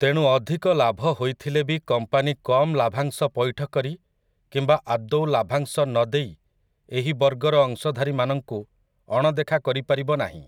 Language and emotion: Odia, neutral